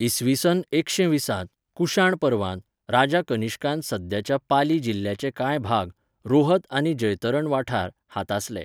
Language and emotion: Goan Konkani, neutral